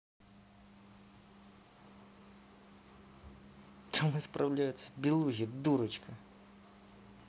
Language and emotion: Russian, angry